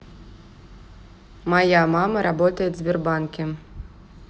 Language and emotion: Russian, neutral